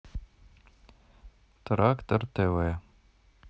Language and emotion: Russian, neutral